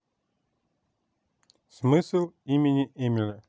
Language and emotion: Russian, neutral